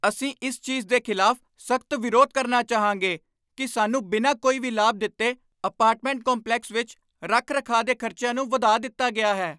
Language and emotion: Punjabi, angry